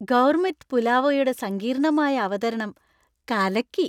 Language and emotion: Malayalam, happy